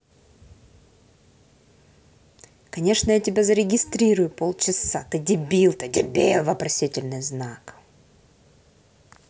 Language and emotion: Russian, angry